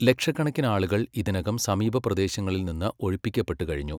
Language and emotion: Malayalam, neutral